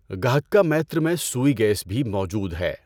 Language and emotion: Urdu, neutral